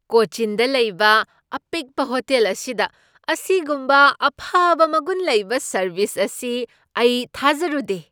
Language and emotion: Manipuri, surprised